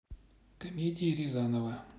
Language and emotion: Russian, neutral